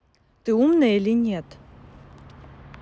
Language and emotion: Russian, neutral